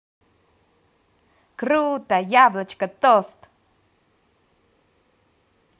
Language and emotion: Russian, positive